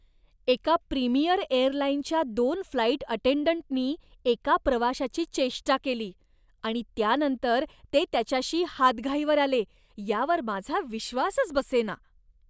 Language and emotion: Marathi, disgusted